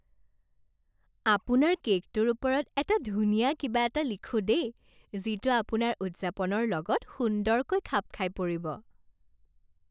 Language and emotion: Assamese, happy